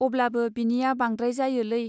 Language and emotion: Bodo, neutral